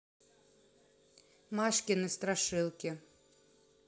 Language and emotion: Russian, neutral